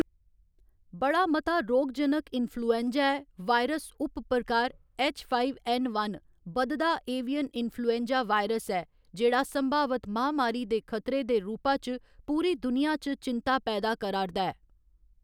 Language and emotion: Dogri, neutral